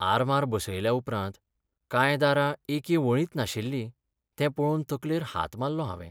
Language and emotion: Goan Konkani, sad